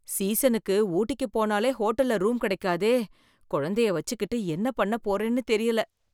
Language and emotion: Tamil, fearful